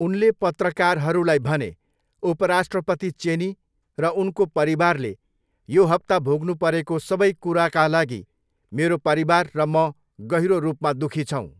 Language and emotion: Nepali, neutral